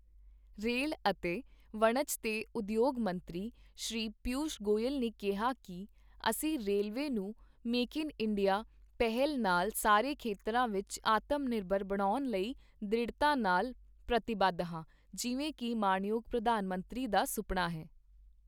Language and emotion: Punjabi, neutral